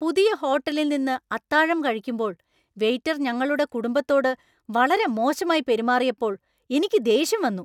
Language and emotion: Malayalam, angry